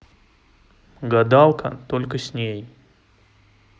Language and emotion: Russian, neutral